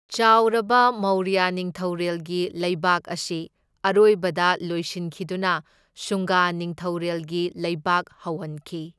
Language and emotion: Manipuri, neutral